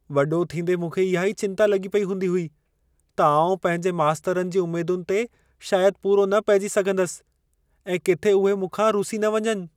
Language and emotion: Sindhi, fearful